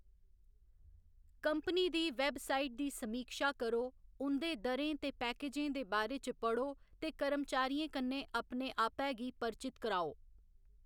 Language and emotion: Dogri, neutral